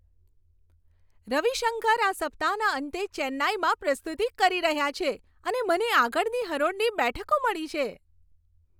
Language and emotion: Gujarati, happy